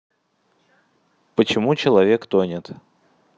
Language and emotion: Russian, neutral